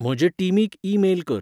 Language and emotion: Goan Konkani, neutral